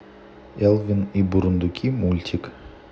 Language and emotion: Russian, neutral